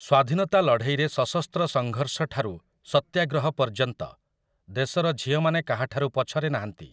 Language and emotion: Odia, neutral